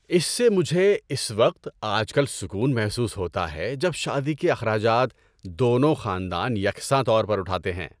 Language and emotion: Urdu, happy